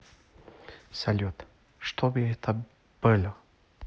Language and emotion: Russian, neutral